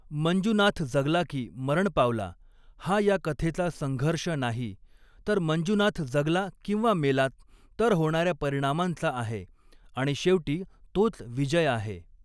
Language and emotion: Marathi, neutral